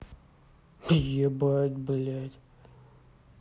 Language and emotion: Russian, angry